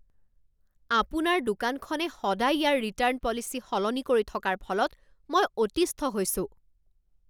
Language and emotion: Assamese, angry